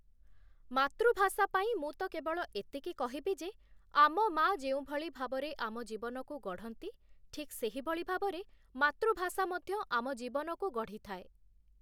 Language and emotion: Odia, neutral